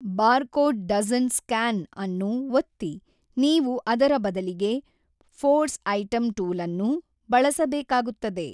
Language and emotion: Kannada, neutral